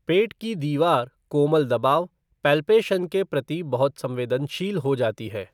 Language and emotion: Hindi, neutral